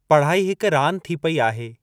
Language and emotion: Sindhi, neutral